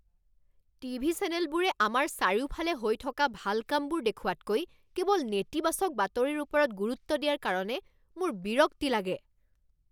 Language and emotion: Assamese, angry